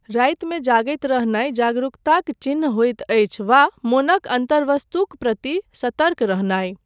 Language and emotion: Maithili, neutral